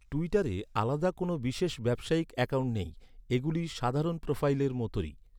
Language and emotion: Bengali, neutral